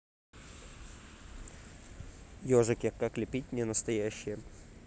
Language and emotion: Russian, neutral